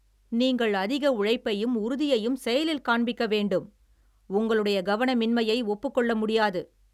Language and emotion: Tamil, angry